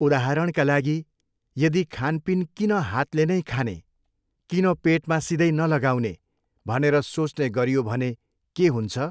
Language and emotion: Nepali, neutral